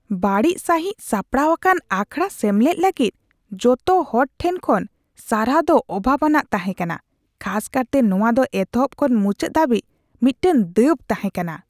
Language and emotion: Santali, disgusted